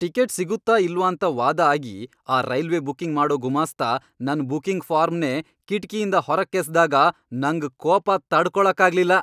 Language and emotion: Kannada, angry